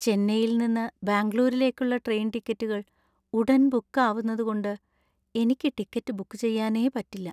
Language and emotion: Malayalam, sad